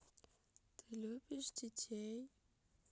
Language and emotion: Russian, sad